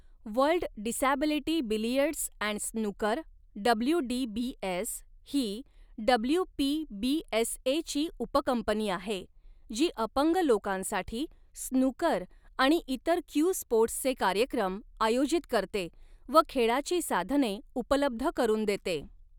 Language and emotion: Marathi, neutral